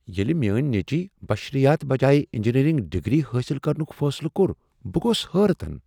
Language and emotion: Kashmiri, surprised